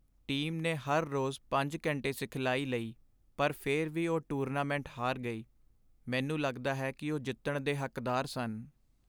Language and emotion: Punjabi, sad